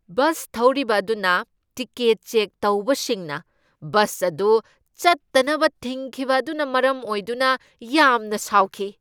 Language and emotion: Manipuri, angry